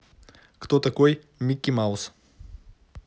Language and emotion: Russian, neutral